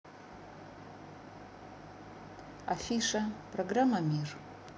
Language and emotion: Russian, neutral